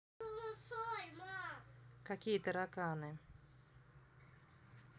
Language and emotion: Russian, neutral